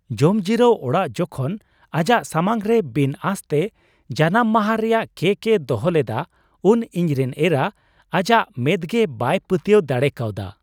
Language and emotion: Santali, surprised